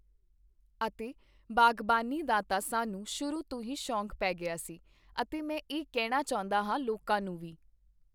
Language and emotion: Punjabi, neutral